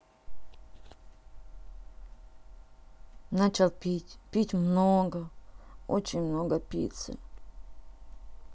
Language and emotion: Russian, sad